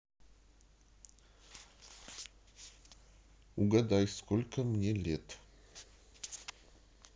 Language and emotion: Russian, neutral